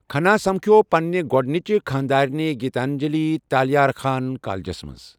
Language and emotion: Kashmiri, neutral